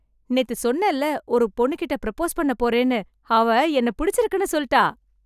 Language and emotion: Tamil, happy